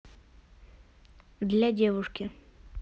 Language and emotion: Russian, neutral